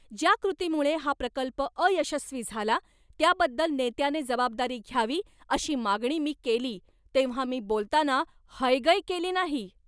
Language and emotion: Marathi, angry